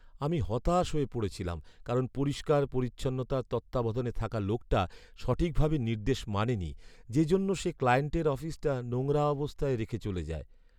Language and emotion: Bengali, sad